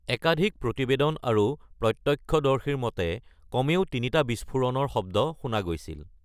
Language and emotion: Assamese, neutral